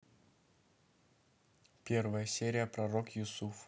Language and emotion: Russian, neutral